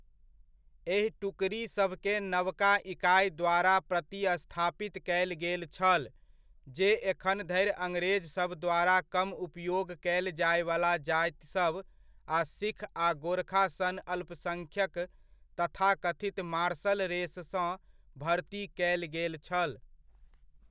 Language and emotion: Maithili, neutral